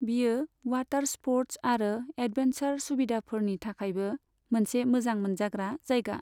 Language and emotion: Bodo, neutral